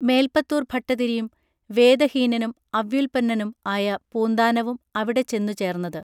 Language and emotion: Malayalam, neutral